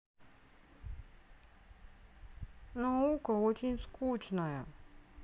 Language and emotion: Russian, sad